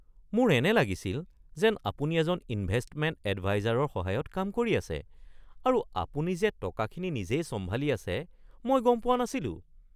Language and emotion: Assamese, surprised